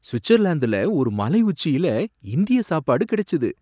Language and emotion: Tamil, surprised